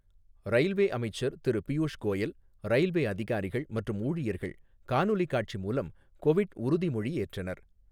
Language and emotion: Tamil, neutral